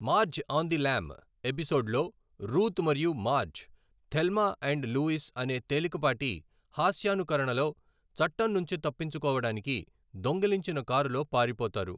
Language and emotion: Telugu, neutral